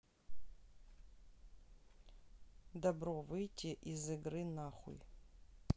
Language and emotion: Russian, neutral